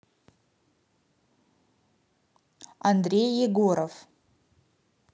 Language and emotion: Russian, neutral